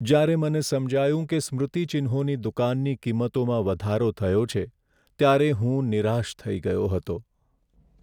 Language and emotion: Gujarati, sad